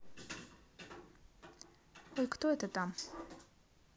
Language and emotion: Russian, neutral